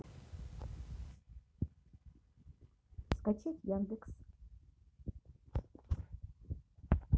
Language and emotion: Russian, neutral